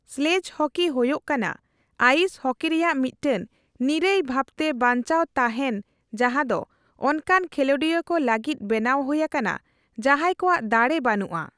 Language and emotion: Santali, neutral